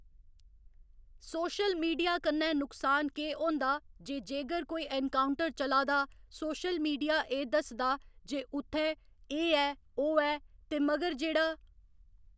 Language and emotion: Dogri, neutral